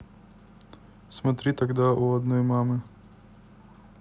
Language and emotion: Russian, neutral